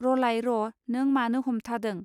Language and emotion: Bodo, neutral